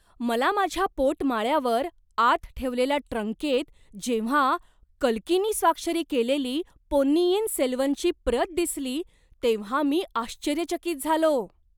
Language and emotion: Marathi, surprised